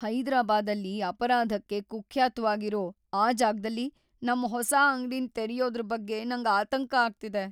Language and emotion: Kannada, fearful